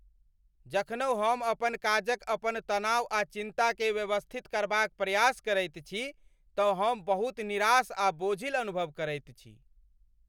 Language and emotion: Maithili, angry